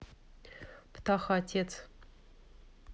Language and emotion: Russian, neutral